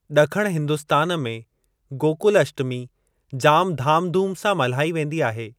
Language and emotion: Sindhi, neutral